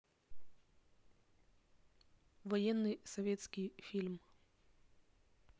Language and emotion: Russian, neutral